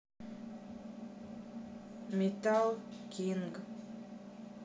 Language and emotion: Russian, neutral